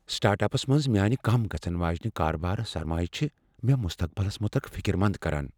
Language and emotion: Kashmiri, fearful